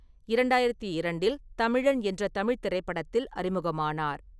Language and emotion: Tamil, neutral